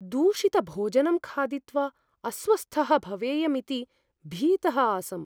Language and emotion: Sanskrit, fearful